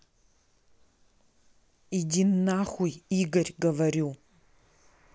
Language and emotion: Russian, angry